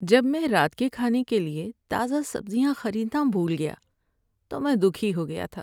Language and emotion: Urdu, sad